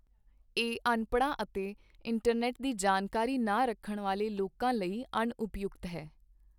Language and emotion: Punjabi, neutral